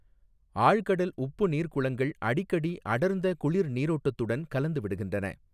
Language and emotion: Tamil, neutral